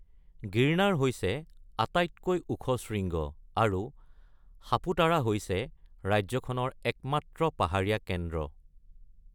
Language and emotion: Assamese, neutral